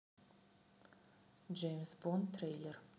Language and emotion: Russian, neutral